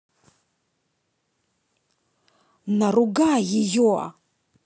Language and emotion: Russian, angry